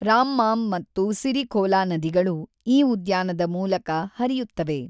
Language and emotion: Kannada, neutral